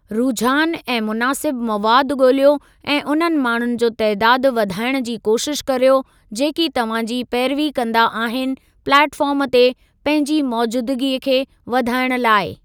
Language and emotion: Sindhi, neutral